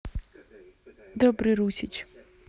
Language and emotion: Russian, neutral